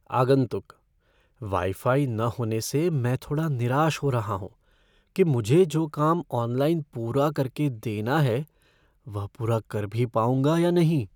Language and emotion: Hindi, fearful